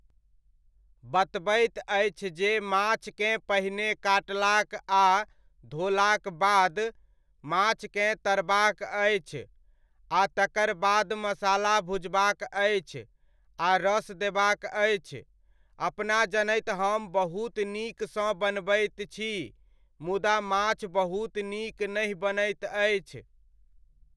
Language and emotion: Maithili, neutral